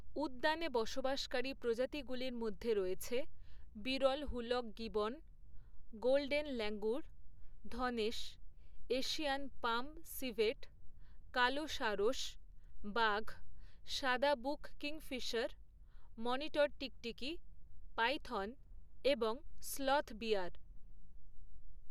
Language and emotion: Bengali, neutral